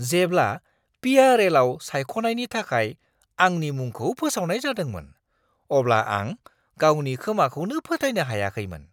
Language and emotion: Bodo, surprised